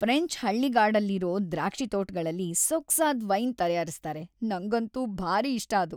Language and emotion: Kannada, happy